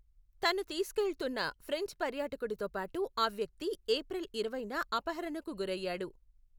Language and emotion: Telugu, neutral